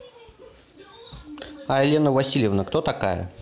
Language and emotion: Russian, neutral